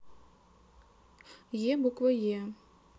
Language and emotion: Russian, neutral